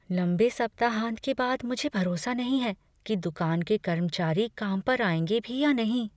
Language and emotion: Hindi, fearful